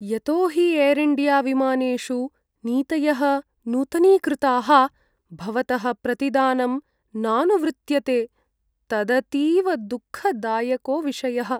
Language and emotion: Sanskrit, sad